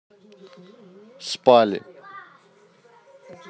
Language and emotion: Russian, neutral